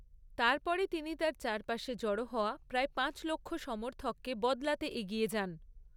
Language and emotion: Bengali, neutral